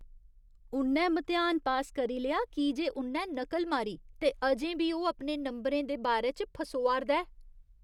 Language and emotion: Dogri, disgusted